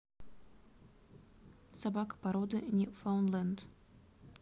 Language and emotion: Russian, neutral